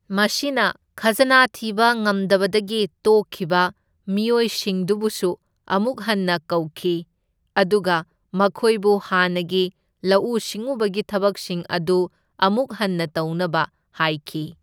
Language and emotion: Manipuri, neutral